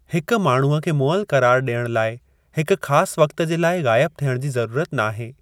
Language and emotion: Sindhi, neutral